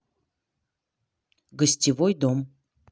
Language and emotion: Russian, neutral